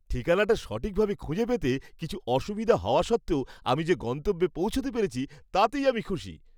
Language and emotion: Bengali, happy